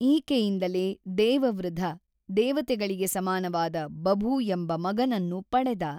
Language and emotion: Kannada, neutral